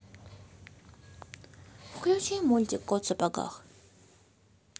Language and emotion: Russian, neutral